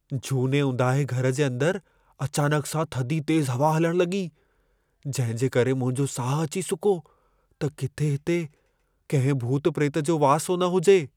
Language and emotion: Sindhi, fearful